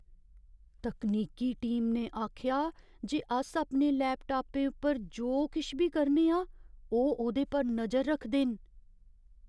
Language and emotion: Dogri, fearful